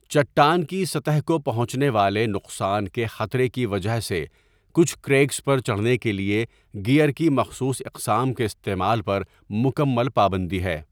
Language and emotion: Urdu, neutral